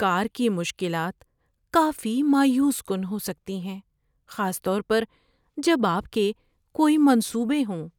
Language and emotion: Urdu, sad